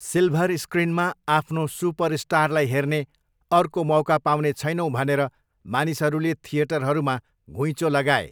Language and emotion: Nepali, neutral